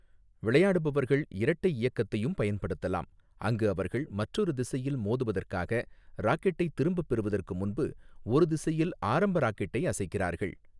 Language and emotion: Tamil, neutral